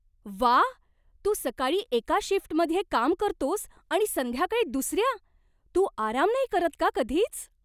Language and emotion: Marathi, surprised